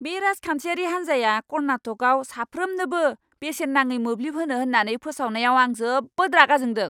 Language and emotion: Bodo, angry